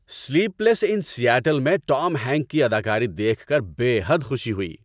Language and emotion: Urdu, happy